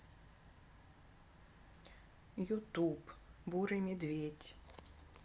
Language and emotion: Russian, sad